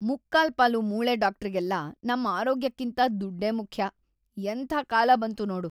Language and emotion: Kannada, disgusted